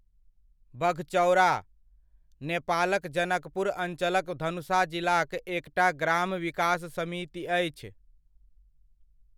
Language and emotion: Maithili, neutral